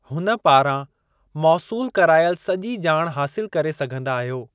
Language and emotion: Sindhi, neutral